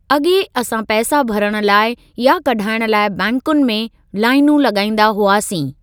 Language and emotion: Sindhi, neutral